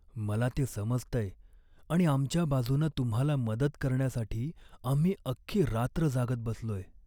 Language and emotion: Marathi, sad